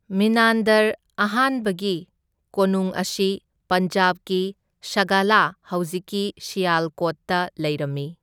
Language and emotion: Manipuri, neutral